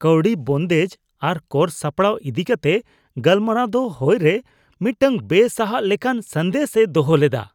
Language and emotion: Santali, disgusted